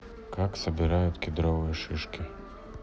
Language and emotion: Russian, neutral